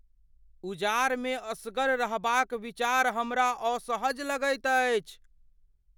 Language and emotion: Maithili, fearful